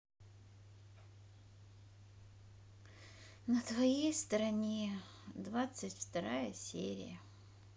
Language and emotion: Russian, sad